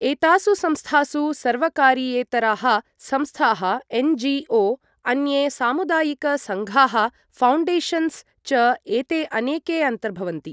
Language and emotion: Sanskrit, neutral